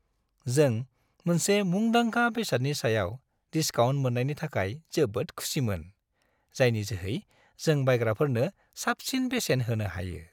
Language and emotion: Bodo, happy